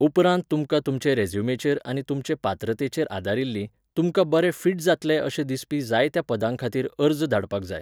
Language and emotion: Goan Konkani, neutral